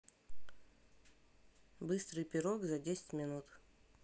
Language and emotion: Russian, neutral